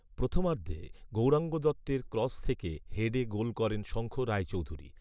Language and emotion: Bengali, neutral